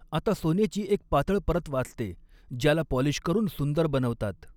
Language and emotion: Marathi, neutral